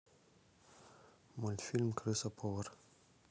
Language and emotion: Russian, neutral